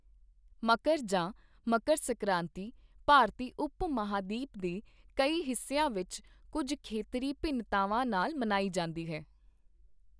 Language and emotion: Punjabi, neutral